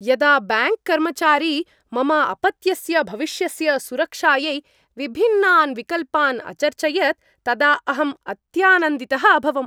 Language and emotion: Sanskrit, happy